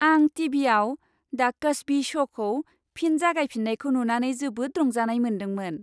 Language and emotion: Bodo, happy